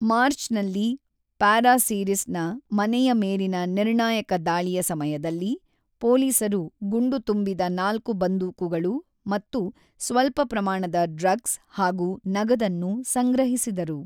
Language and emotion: Kannada, neutral